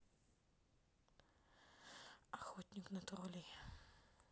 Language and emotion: Russian, sad